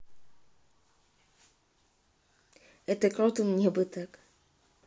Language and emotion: Russian, neutral